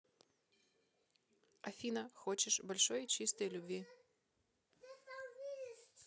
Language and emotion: Russian, neutral